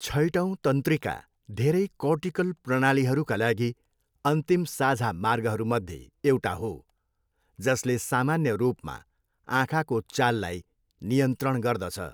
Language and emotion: Nepali, neutral